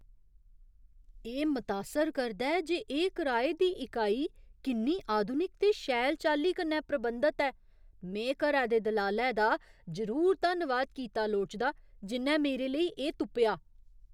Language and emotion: Dogri, surprised